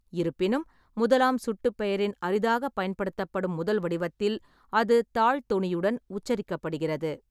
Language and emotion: Tamil, neutral